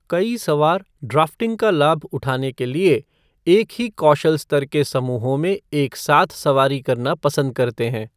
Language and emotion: Hindi, neutral